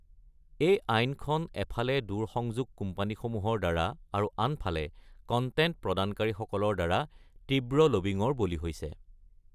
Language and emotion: Assamese, neutral